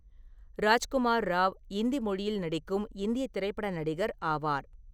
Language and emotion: Tamil, neutral